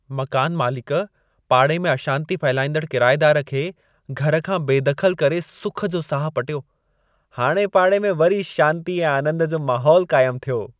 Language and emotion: Sindhi, happy